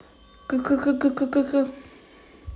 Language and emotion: Russian, positive